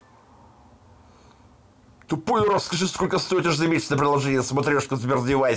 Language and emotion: Russian, angry